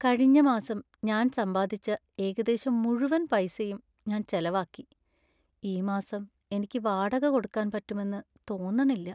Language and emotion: Malayalam, sad